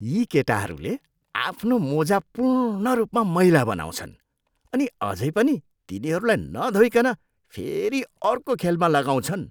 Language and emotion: Nepali, disgusted